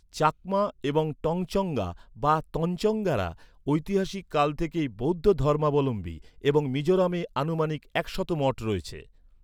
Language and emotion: Bengali, neutral